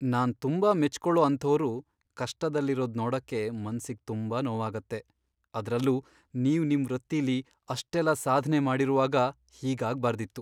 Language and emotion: Kannada, sad